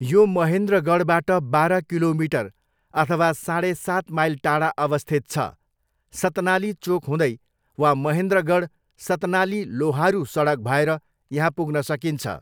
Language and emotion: Nepali, neutral